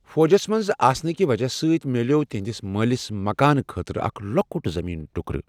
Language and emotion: Kashmiri, neutral